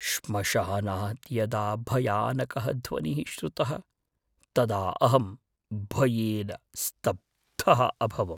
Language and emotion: Sanskrit, fearful